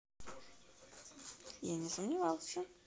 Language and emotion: Russian, neutral